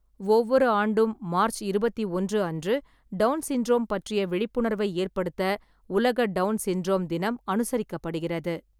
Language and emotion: Tamil, neutral